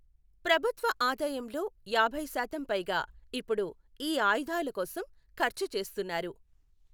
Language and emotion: Telugu, neutral